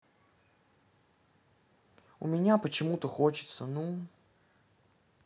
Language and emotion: Russian, neutral